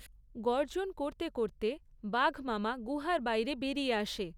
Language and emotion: Bengali, neutral